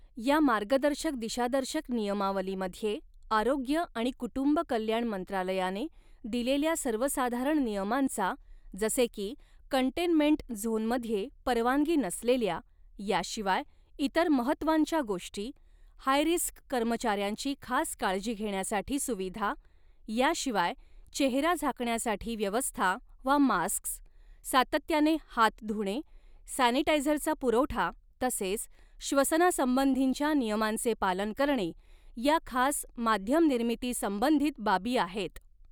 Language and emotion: Marathi, neutral